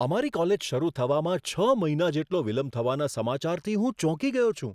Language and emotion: Gujarati, surprised